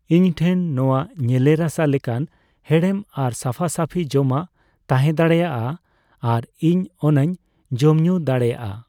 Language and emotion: Santali, neutral